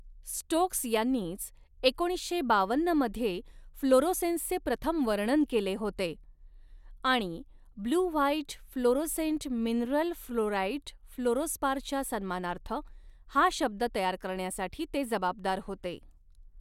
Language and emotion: Marathi, neutral